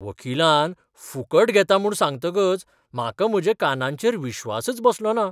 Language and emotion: Goan Konkani, surprised